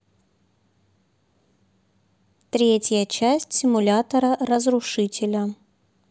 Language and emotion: Russian, neutral